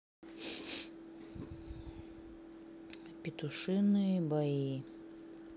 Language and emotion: Russian, sad